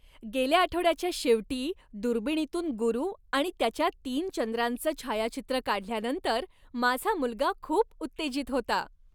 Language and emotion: Marathi, happy